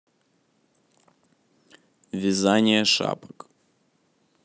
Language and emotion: Russian, neutral